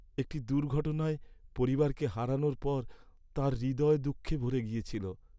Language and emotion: Bengali, sad